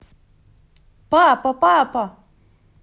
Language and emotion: Russian, positive